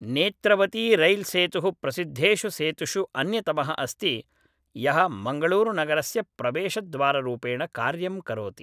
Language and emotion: Sanskrit, neutral